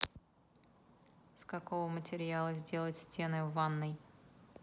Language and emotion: Russian, neutral